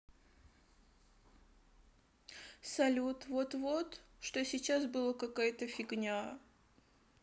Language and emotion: Russian, sad